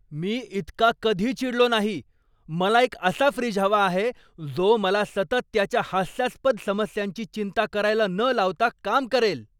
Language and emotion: Marathi, angry